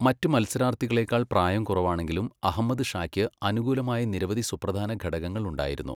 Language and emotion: Malayalam, neutral